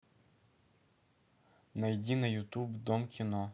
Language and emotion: Russian, neutral